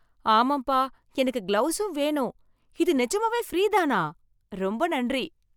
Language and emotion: Tamil, happy